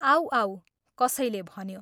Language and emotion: Nepali, neutral